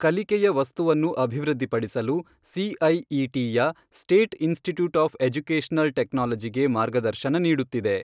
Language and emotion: Kannada, neutral